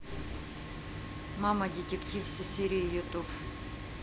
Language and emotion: Russian, neutral